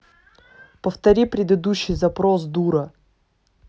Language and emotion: Russian, angry